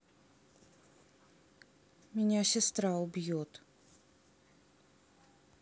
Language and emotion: Russian, sad